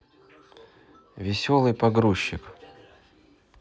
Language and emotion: Russian, neutral